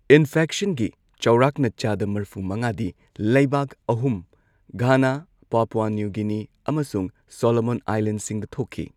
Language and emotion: Manipuri, neutral